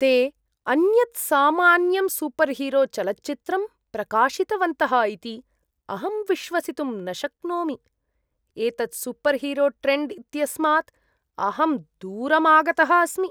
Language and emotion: Sanskrit, disgusted